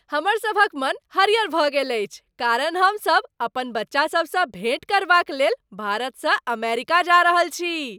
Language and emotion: Maithili, happy